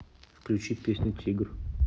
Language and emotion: Russian, neutral